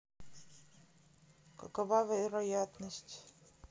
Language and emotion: Russian, neutral